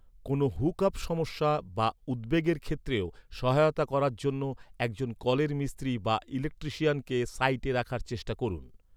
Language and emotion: Bengali, neutral